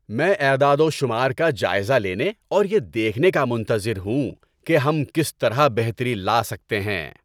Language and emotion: Urdu, happy